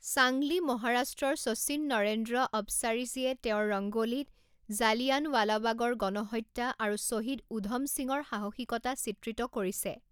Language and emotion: Assamese, neutral